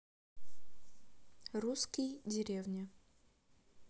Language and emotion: Russian, neutral